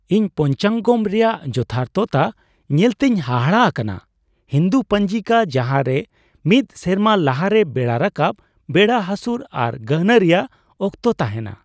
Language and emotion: Santali, surprised